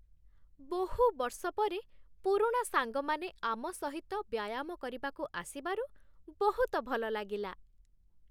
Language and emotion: Odia, happy